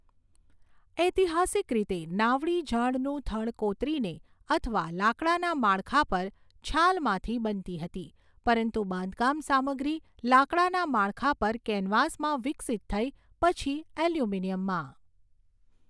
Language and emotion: Gujarati, neutral